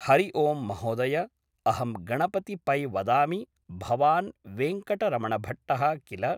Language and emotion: Sanskrit, neutral